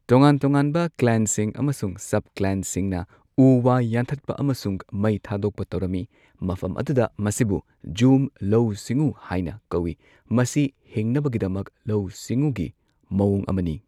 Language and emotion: Manipuri, neutral